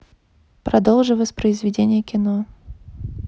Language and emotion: Russian, neutral